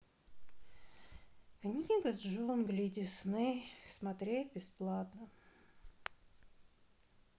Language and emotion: Russian, sad